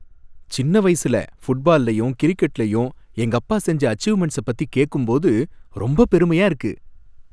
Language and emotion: Tamil, happy